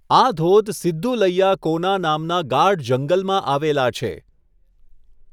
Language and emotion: Gujarati, neutral